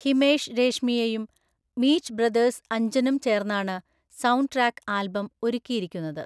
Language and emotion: Malayalam, neutral